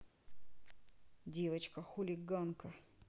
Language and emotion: Russian, angry